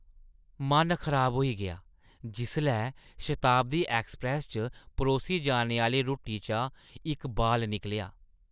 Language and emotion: Dogri, disgusted